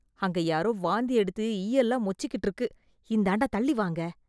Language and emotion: Tamil, disgusted